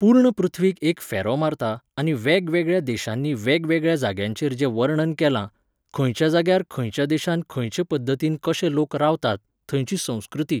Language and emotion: Goan Konkani, neutral